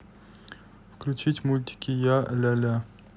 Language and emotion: Russian, neutral